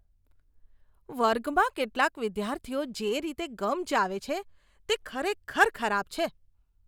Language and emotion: Gujarati, disgusted